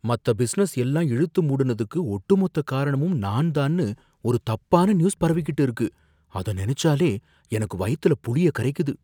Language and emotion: Tamil, fearful